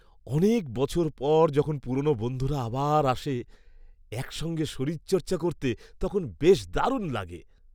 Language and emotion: Bengali, happy